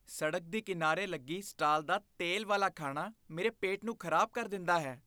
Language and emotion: Punjabi, disgusted